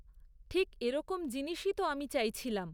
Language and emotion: Bengali, neutral